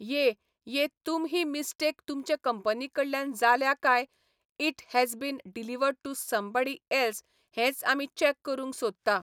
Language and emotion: Goan Konkani, neutral